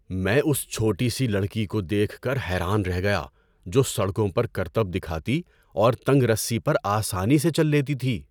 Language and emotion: Urdu, surprised